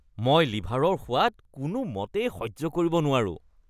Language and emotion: Assamese, disgusted